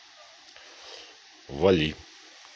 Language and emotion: Russian, neutral